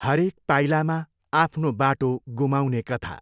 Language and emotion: Nepali, neutral